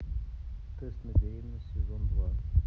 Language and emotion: Russian, neutral